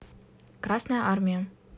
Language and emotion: Russian, neutral